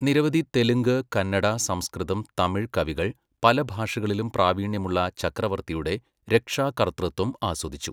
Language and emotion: Malayalam, neutral